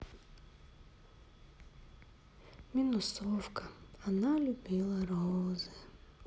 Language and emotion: Russian, sad